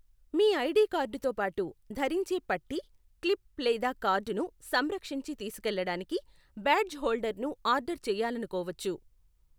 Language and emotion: Telugu, neutral